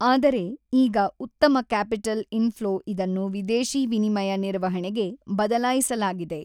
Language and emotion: Kannada, neutral